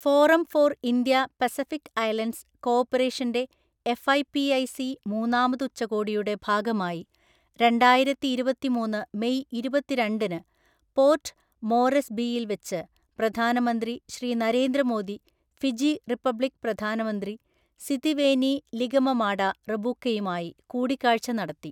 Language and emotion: Malayalam, neutral